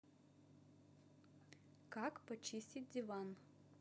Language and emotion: Russian, neutral